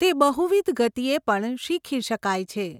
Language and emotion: Gujarati, neutral